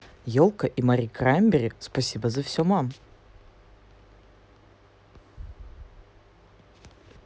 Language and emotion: Russian, positive